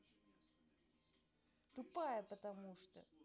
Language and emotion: Russian, angry